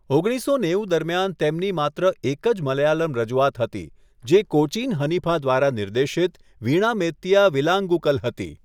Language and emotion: Gujarati, neutral